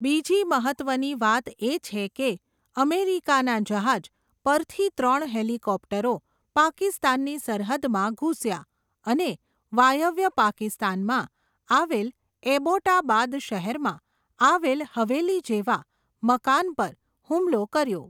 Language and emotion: Gujarati, neutral